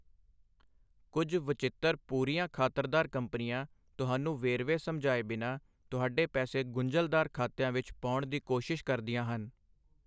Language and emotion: Punjabi, neutral